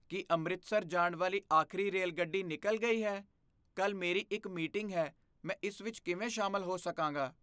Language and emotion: Punjabi, fearful